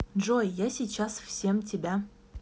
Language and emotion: Russian, neutral